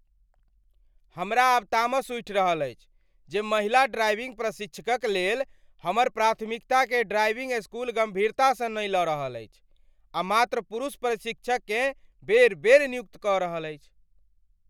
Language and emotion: Maithili, angry